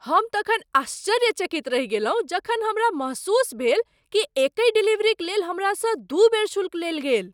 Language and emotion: Maithili, surprised